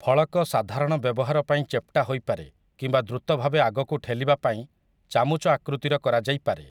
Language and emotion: Odia, neutral